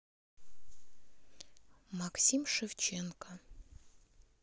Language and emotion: Russian, neutral